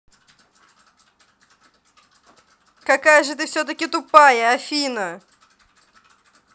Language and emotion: Russian, neutral